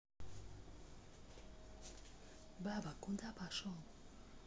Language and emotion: Russian, neutral